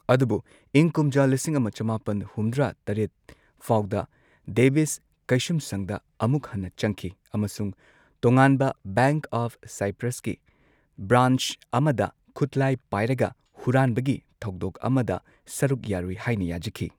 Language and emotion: Manipuri, neutral